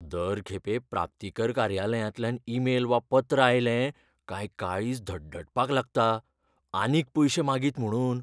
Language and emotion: Goan Konkani, fearful